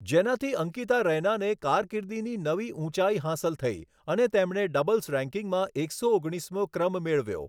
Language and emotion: Gujarati, neutral